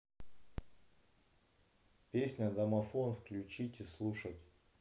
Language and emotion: Russian, neutral